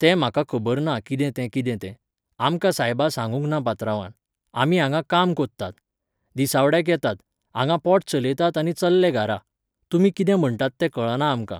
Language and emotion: Goan Konkani, neutral